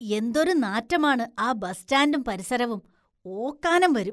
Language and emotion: Malayalam, disgusted